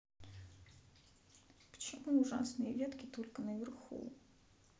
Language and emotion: Russian, sad